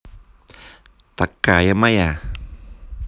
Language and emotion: Russian, positive